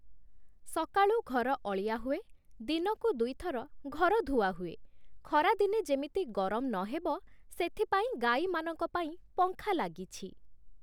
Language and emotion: Odia, neutral